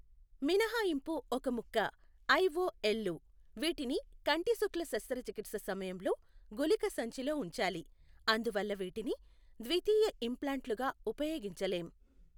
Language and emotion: Telugu, neutral